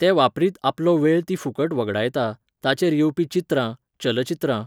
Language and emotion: Goan Konkani, neutral